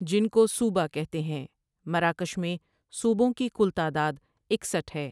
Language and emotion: Urdu, neutral